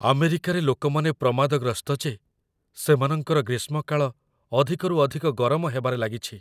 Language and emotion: Odia, fearful